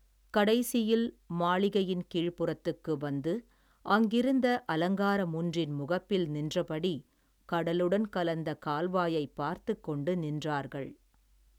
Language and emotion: Tamil, neutral